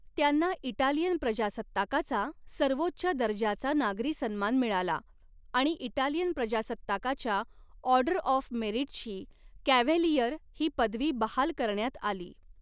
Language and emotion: Marathi, neutral